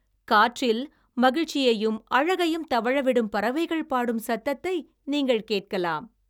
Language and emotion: Tamil, happy